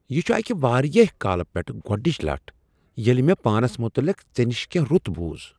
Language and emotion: Kashmiri, surprised